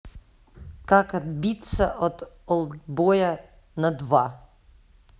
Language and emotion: Russian, neutral